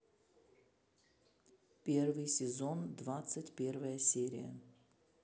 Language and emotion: Russian, neutral